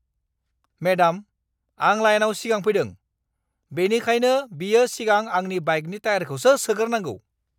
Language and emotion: Bodo, angry